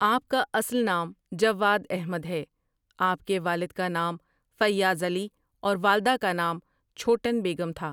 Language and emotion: Urdu, neutral